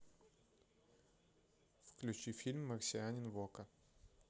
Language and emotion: Russian, neutral